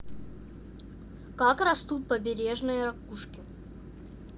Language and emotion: Russian, neutral